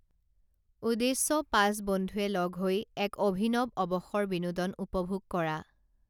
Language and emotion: Assamese, neutral